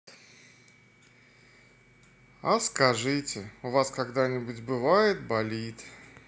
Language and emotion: Russian, sad